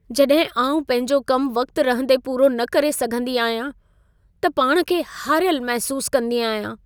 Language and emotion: Sindhi, sad